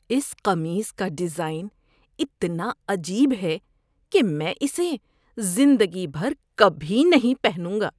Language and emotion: Urdu, disgusted